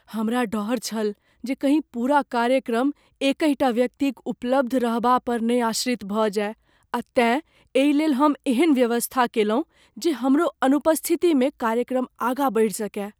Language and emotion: Maithili, fearful